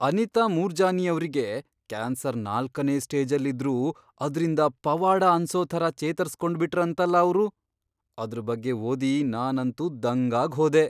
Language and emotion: Kannada, surprised